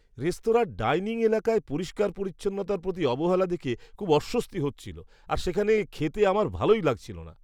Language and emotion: Bengali, disgusted